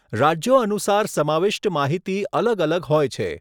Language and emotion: Gujarati, neutral